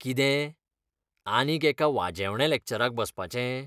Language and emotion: Goan Konkani, disgusted